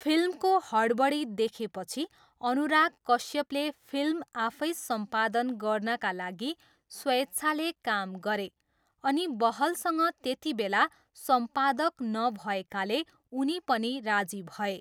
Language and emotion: Nepali, neutral